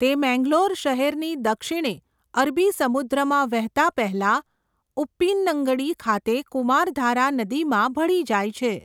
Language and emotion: Gujarati, neutral